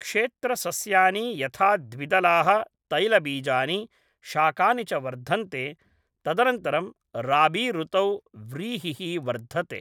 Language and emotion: Sanskrit, neutral